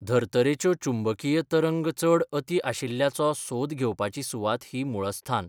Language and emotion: Goan Konkani, neutral